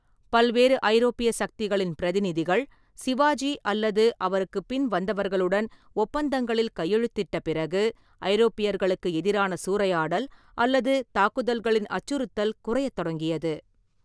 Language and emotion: Tamil, neutral